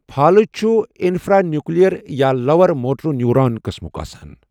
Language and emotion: Kashmiri, neutral